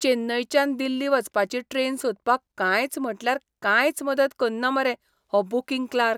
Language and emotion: Goan Konkani, disgusted